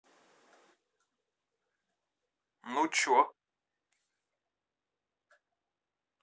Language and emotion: Russian, neutral